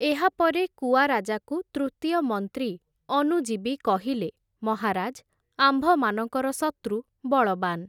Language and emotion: Odia, neutral